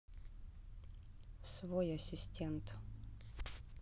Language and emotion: Russian, neutral